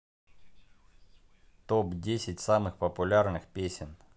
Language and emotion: Russian, neutral